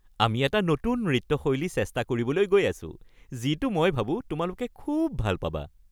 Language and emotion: Assamese, happy